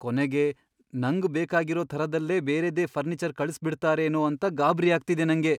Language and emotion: Kannada, fearful